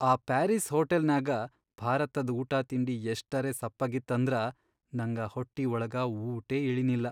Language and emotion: Kannada, sad